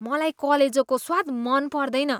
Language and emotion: Nepali, disgusted